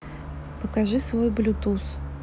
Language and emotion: Russian, neutral